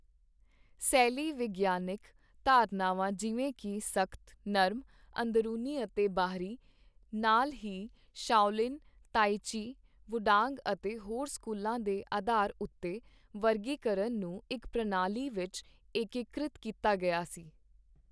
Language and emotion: Punjabi, neutral